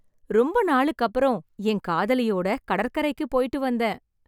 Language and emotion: Tamil, happy